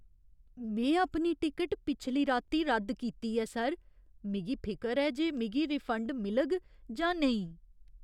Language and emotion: Dogri, fearful